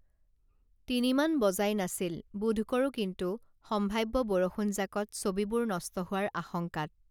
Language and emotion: Assamese, neutral